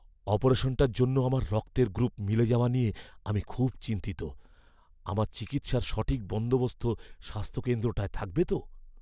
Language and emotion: Bengali, fearful